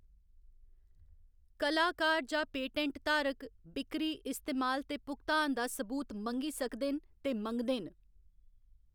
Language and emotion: Dogri, neutral